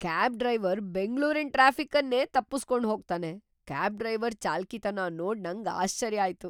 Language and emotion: Kannada, surprised